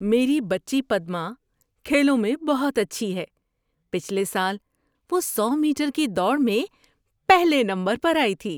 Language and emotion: Urdu, happy